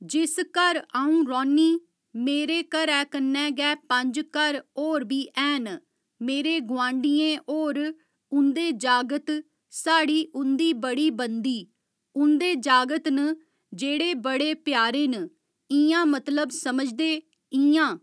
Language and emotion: Dogri, neutral